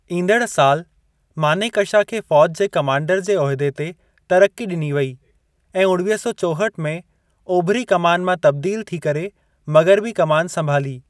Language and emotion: Sindhi, neutral